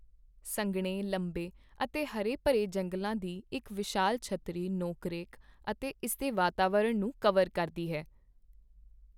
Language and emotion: Punjabi, neutral